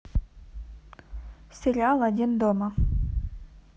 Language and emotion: Russian, neutral